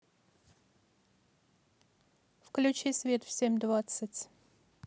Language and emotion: Russian, neutral